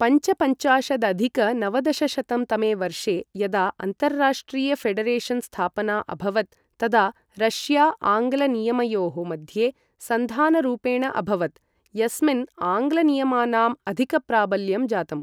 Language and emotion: Sanskrit, neutral